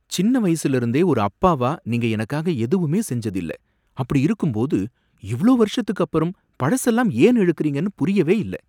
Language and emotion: Tamil, surprised